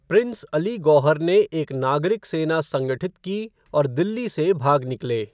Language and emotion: Hindi, neutral